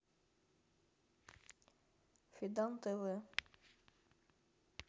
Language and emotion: Russian, neutral